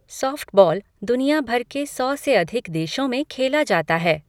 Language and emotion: Hindi, neutral